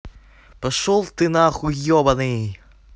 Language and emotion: Russian, angry